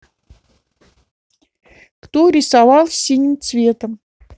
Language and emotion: Russian, neutral